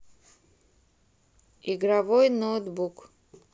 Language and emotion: Russian, neutral